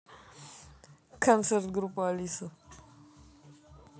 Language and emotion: Russian, neutral